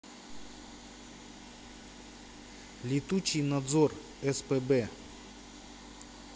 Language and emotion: Russian, neutral